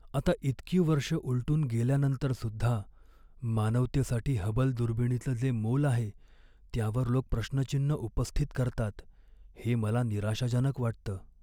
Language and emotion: Marathi, sad